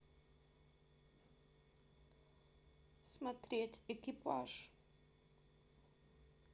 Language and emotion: Russian, neutral